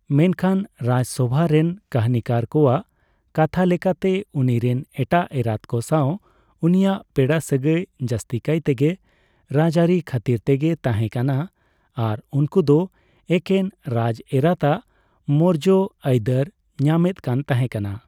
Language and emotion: Santali, neutral